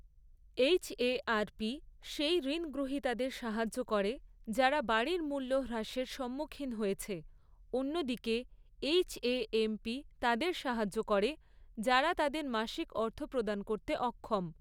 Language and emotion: Bengali, neutral